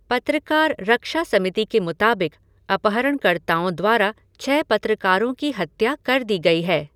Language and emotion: Hindi, neutral